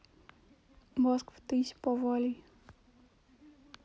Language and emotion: Russian, neutral